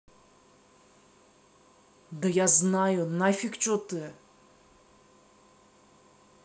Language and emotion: Russian, angry